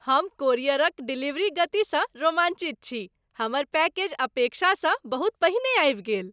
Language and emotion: Maithili, happy